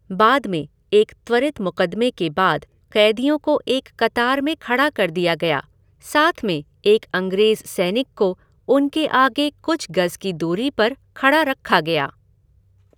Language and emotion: Hindi, neutral